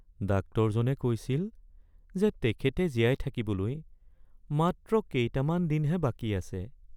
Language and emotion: Assamese, sad